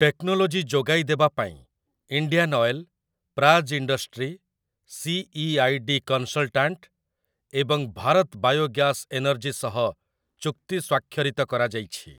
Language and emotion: Odia, neutral